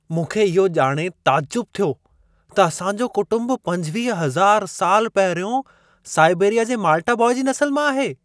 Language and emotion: Sindhi, surprised